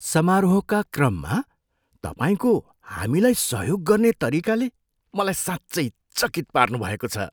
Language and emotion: Nepali, surprised